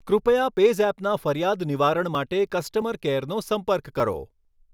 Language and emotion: Gujarati, neutral